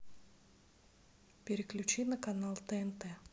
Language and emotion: Russian, neutral